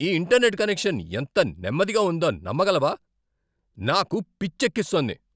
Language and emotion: Telugu, angry